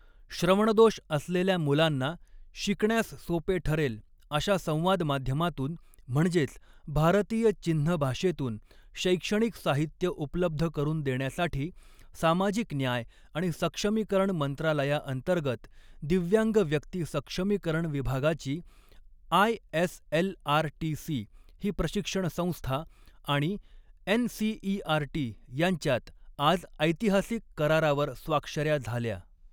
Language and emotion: Marathi, neutral